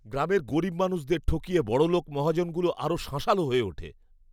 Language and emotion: Bengali, disgusted